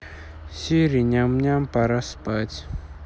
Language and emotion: Russian, neutral